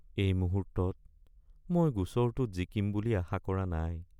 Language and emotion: Assamese, sad